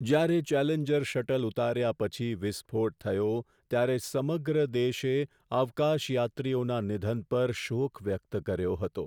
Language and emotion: Gujarati, sad